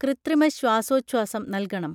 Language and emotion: Malayalam, neutral